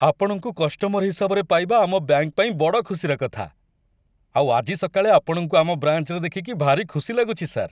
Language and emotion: Odia, happy